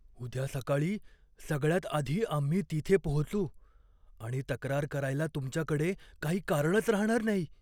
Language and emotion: Marathi, fearful